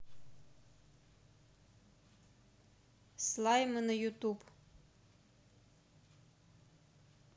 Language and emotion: Russian, neutral